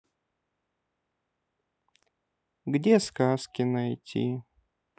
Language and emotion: Russian, sad